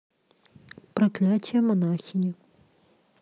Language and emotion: Russian, neutral